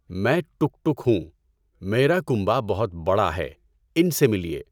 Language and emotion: Urdu, neutral